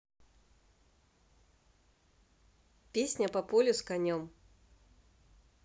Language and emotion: Russian, neutral